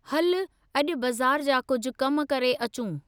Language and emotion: Sindhi, neutral